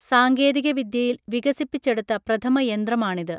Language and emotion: Malayalam, neutral